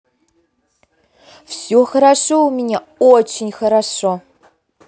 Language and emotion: Russian, positive